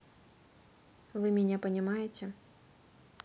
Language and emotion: Russian, neutral